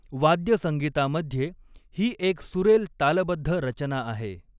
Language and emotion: Marathi, neutral